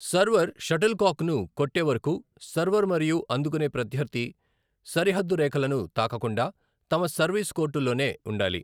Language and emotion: Telugu, neutral